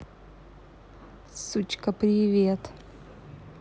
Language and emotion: Russian, angry